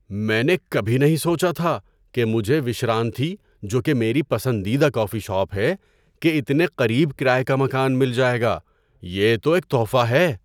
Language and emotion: Urdu, surprised